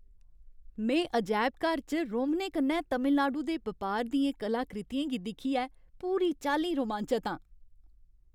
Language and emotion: Dogri, happy